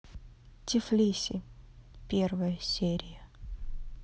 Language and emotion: Russian, neutral